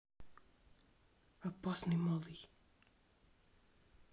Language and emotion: Russian, neutral